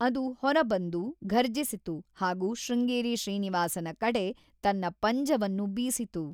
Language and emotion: Kannada, neutral